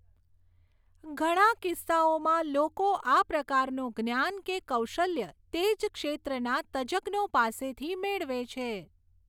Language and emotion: Gujarati, neutral